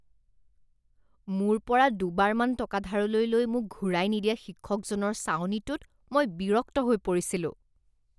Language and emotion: Assamese, disgusted